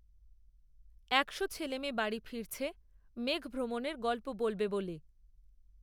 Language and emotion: Bengali, neutral